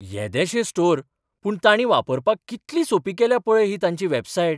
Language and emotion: Goan Konkani, surprised